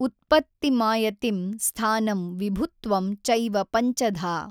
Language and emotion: Kannada, neutral